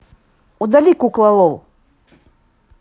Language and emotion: Russian, neutral